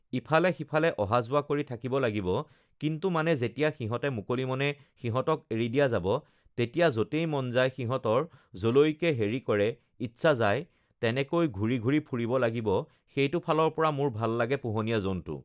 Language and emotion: Assamese, neutral